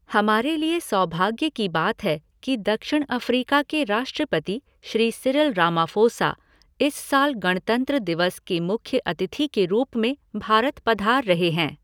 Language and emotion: Hindi, neutral